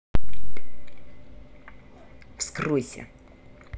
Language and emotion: Russian, angry